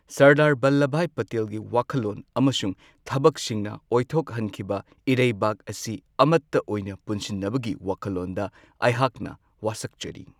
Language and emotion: Manipuri, neutral